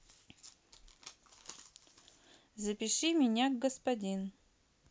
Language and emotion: Russian, neutral